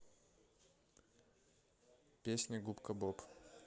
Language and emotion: Russian, neutral